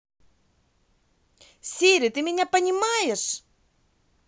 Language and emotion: Russian, angry